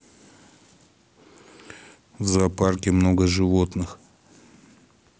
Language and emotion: Russian, neutral